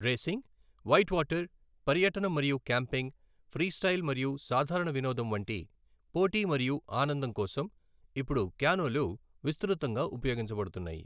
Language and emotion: Telugu, neutral